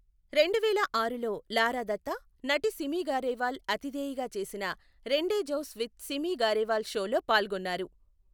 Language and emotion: Telugu, neutral